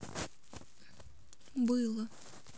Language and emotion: Russian, sad